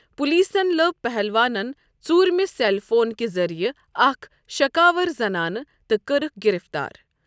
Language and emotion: Kashmiri, neutral